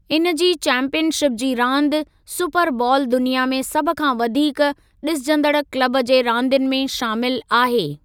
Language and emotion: Sindhi, neutral